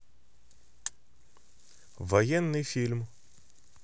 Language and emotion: Russian, neutral